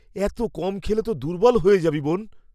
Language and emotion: Bengali, fearful